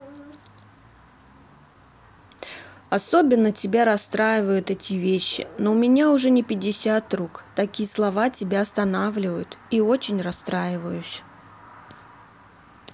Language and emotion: Russian, sad